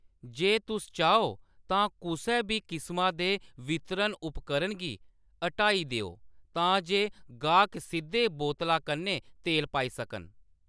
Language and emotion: Dogri, neutral